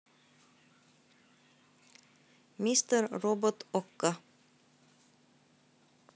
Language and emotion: Russian, neutral